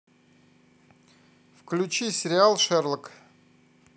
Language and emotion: Russian, neutral